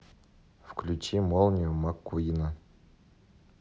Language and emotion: Russian, neutral